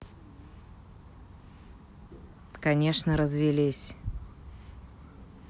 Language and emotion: Russian, neutral